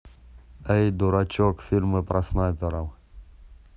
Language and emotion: Russian, neutral